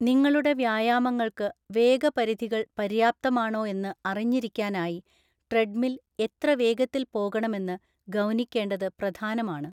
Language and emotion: Malayalam, neutral